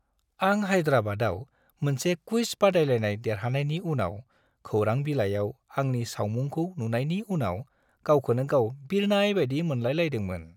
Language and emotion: Bodo, happy